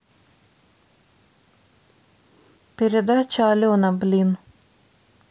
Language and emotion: Russian, angry